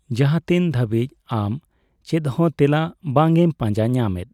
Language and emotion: Santali, neutral